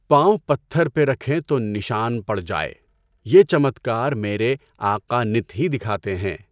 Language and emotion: Urdu, neutral